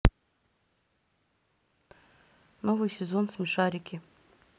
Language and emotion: Russian, neutral